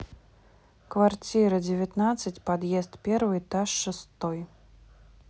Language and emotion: Russian, neutral